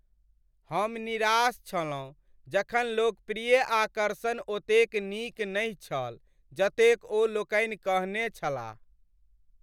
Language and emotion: Maithili, sad